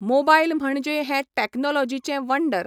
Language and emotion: Goan Konkani, neutral